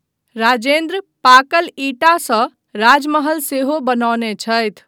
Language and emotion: Maithili, neutral